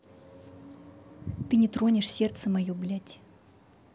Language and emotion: Russian, angry